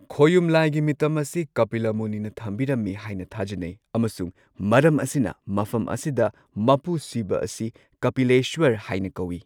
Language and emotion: Manipuri, neutral